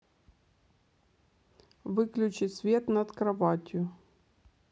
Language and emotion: Russian, neutral